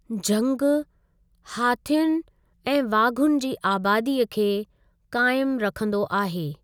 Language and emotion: Sindhi, neutral